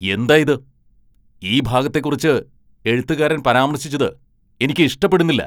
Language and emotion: Malayalam, angry